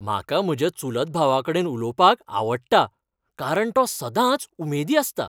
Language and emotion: Goan Konkani, happy